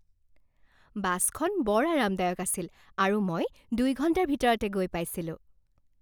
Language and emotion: Assamese, happy